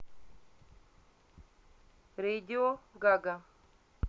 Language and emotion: Russian, neutral